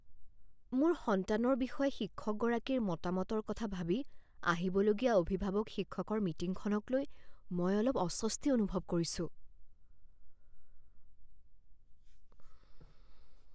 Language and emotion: Assamese, fearful